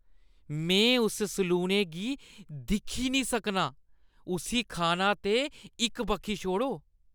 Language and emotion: Dogri, disgusted